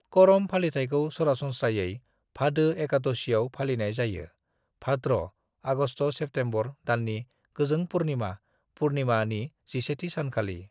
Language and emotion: Bodo, neutral